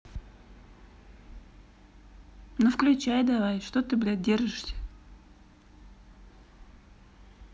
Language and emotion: Russian, neutral